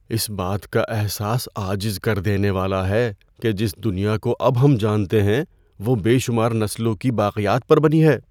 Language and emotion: Urdu, fearful